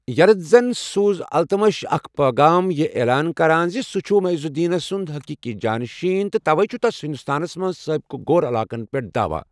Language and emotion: Kashmiri, neutral